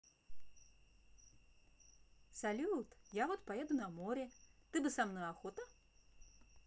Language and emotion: Russian, positive